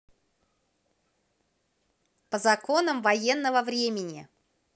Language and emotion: Russian, positive